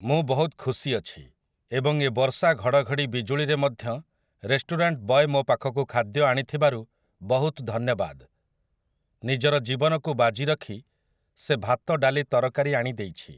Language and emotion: Odia, neutral